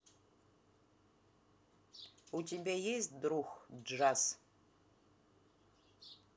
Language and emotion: Russian, neutral